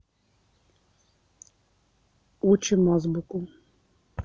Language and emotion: Russian, neutral